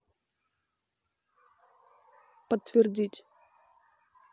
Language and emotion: Russian, neutral